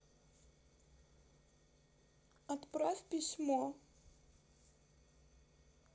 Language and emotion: Russian, sad